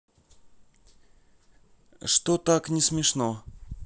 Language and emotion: Russian, neutral